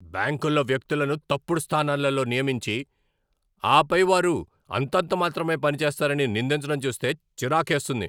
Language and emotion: Telugu, angry